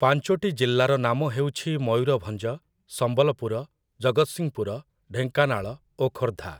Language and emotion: Odia, neutral